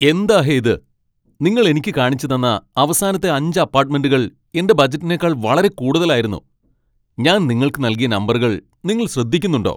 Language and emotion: Malayalam, angry